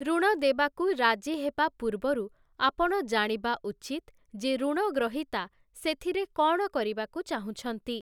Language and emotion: Odia, neutral